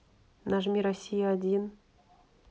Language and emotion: Russian, neutral